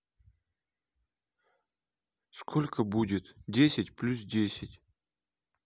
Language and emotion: Russian, neutral